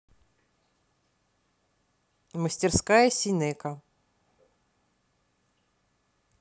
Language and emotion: Russian, neutral